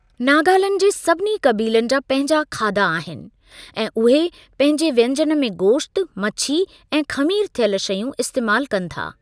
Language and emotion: Sindhi, neutral